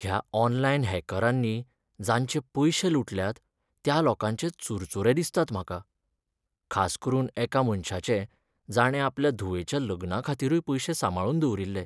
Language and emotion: Goan Konkani, sad